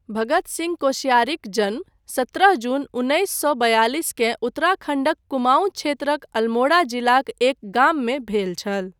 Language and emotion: Maithili, neutral